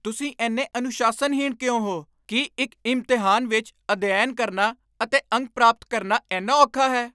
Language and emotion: Punjabi, angry